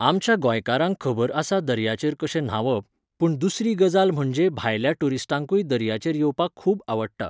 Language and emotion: Goan Konkani, neutral